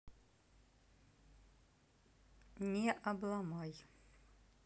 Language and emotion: Russian, neutral